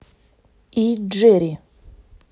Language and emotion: Russian, neutral